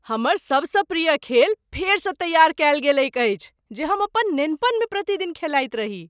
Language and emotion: Maithili, surprised